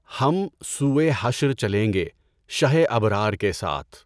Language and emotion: Urdu, neutral